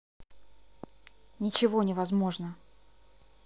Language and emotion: Russian, angry